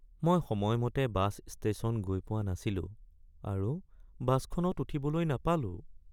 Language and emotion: Assamese, sad